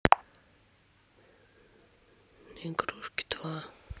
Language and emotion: Russian, sad